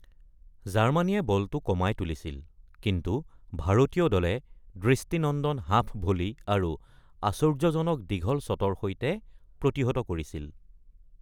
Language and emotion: Assamese, neutral